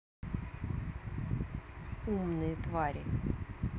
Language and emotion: Russian, neutral